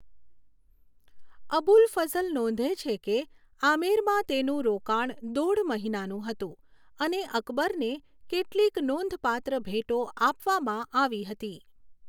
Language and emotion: Gujarati, neutral